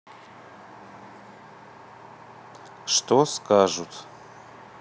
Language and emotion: Russian, neutral